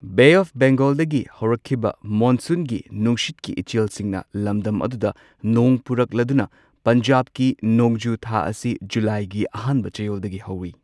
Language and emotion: Manipuri, neutral